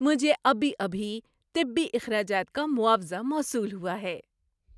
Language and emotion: Urdu, happy